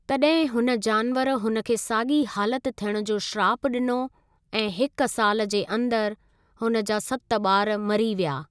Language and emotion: Sindhi, neutral